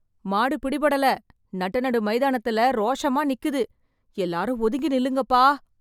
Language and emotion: Tamil, fearful